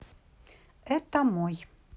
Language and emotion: Russian, neutral